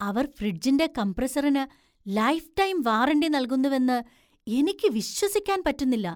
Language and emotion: Malayalam, surprised